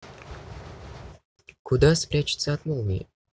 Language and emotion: Russian, neutral